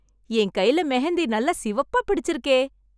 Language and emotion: Tamil, happy